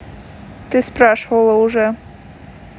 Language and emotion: Russian, neutral